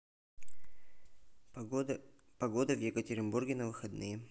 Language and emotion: Russian, neutral